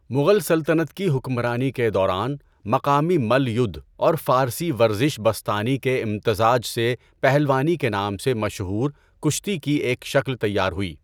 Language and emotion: Urdu, neutral